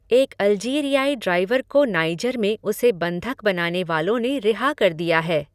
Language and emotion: Hindi, neutral